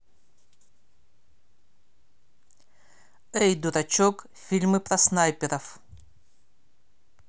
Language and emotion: Russian, neutral